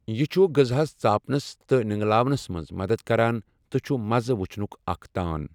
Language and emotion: Kashmiri, neutral